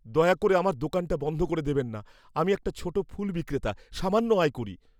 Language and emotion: Bengali, fearful